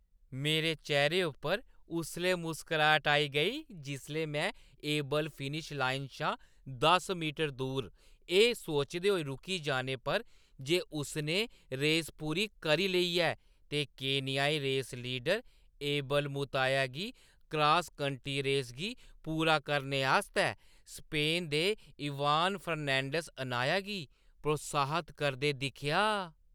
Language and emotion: Dogri, happy